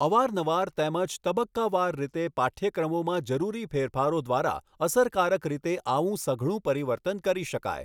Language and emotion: Gujarati, neutral